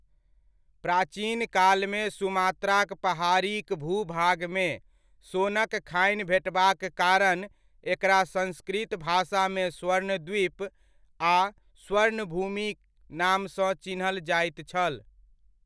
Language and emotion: Maithili, neutral